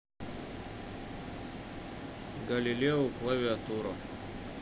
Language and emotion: Russian, neutral